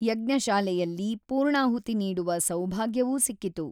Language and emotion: Kannada, neutral